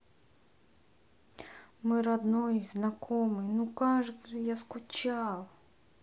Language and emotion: Russian, sad